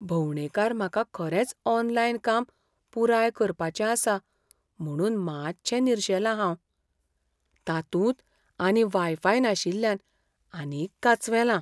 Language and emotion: Goan Konkani, fearful